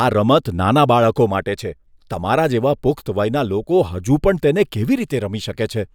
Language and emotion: Gujarati, disgusted